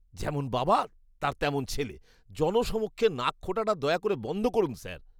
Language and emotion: Bengali, disgusted